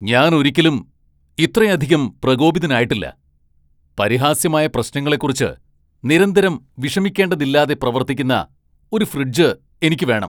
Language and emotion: Malayalam, angry